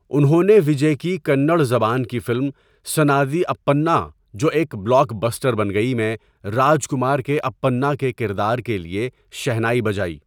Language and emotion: Urdu, neutral